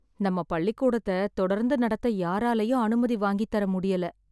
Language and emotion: Tamil, sad